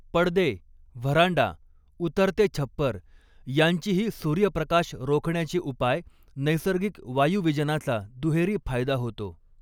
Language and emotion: Marathi, neutral